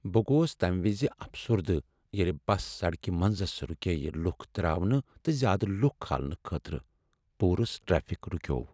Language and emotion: Kashmiri, sad